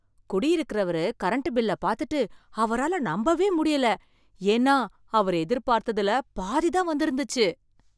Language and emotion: Tamil, surprised